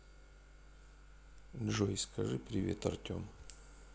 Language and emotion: Russian, sad